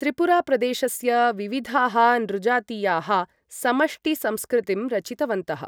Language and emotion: Sanskrit, neutral